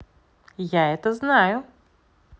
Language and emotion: Russian, positive